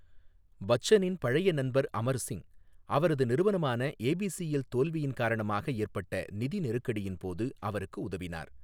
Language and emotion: Tamil, neutral